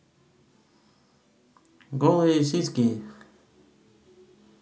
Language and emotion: Russian, positive